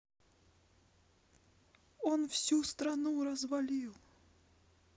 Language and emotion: Russian, sad